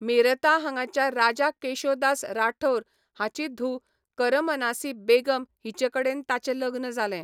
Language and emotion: Goan Konkani, neutral